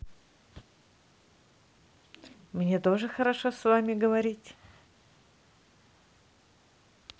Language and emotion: Russian, positive